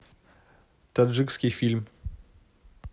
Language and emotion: Russian, neutral